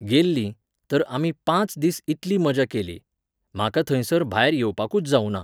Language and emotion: Goan Konkani, neutral